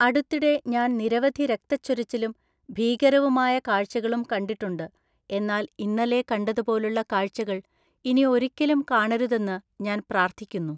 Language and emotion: Malayalam, neutral